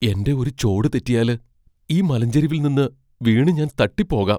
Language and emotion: Malayalam, fearful